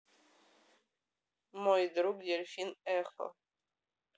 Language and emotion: Russian, neutral